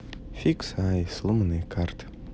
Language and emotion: Russian, sad